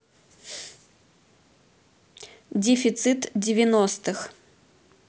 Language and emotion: Russian, neutral